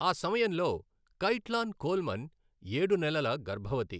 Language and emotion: Telugu, neutral